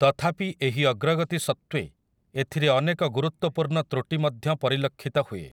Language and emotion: Odia, neutral